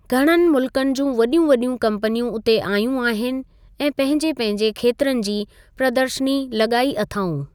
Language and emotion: Sindhi, neutral